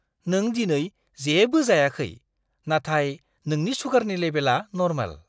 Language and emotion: Bodo, surprised